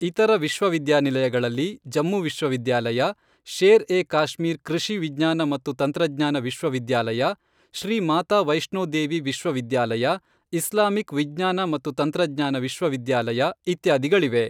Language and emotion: Kannada, neutral